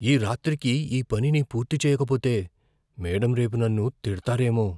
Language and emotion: Telugu, fearful